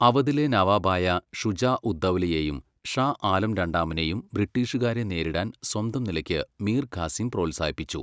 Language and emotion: Malayalam, neutral